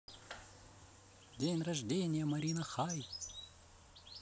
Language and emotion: Russian, positive